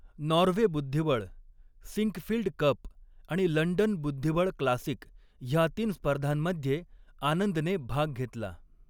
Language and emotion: Marathi, neutral